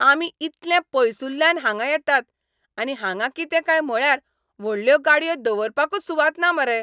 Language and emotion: Goan Konkani, angry